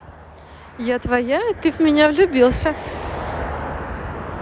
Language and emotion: Russian, positive